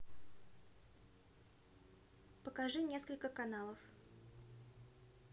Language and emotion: Russian, neutral